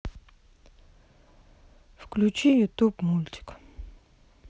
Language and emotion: Russian, sad